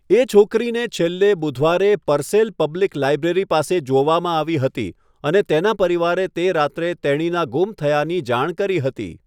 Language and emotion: Gujarati, neutral